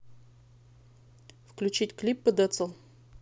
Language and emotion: Russian, neutral